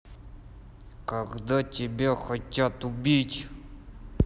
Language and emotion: Russian, angry